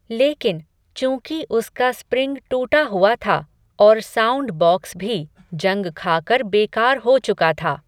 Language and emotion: Hindi, neutral